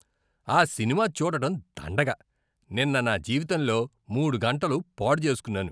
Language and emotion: Telugu, disgusted